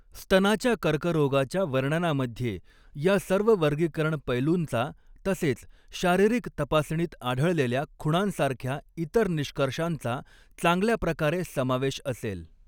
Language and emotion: Marathi, neutral